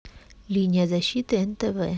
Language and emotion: Russian, neutral